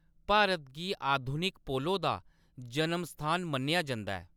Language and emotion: Dogri, neutral